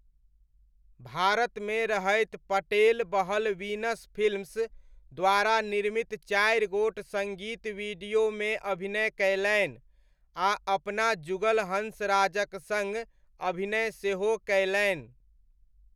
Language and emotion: Maithili, neutral